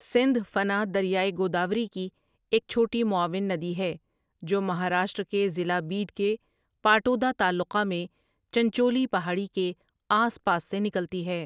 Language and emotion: Urdu, neutral